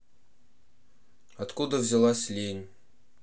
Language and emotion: Russian, neutral